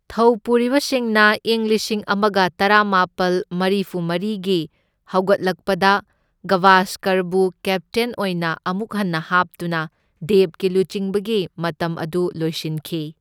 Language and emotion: Manipuri, neutral